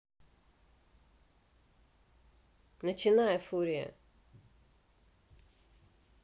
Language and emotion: Russian, neutral